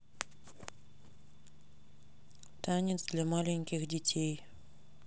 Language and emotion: Russian, neutral